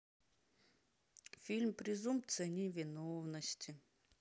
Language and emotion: Russian, sad